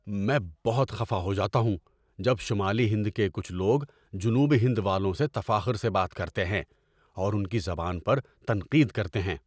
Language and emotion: Urdu, angry